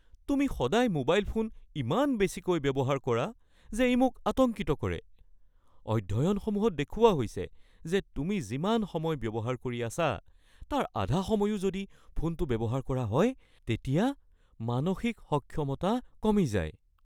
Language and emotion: Assamese, fearful